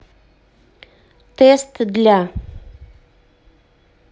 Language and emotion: Russian, neutral